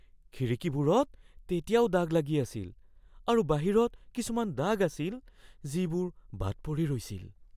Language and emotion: Assamese, fearful